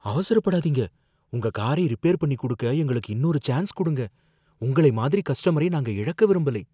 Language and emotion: Tamil, fearful